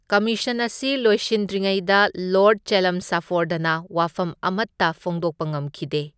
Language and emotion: Manipuri, neutral